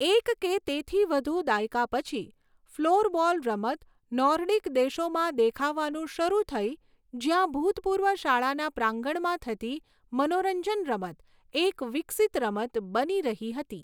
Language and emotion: Gujarati, neutral